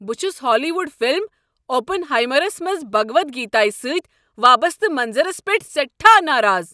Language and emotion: Kashmiri, angry